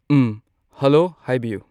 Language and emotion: Manipuri, neutral